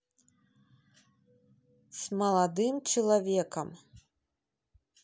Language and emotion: Russian, neutral